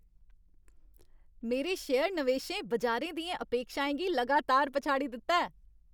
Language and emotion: Dogri, happy